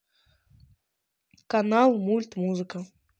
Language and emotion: Russian, neutral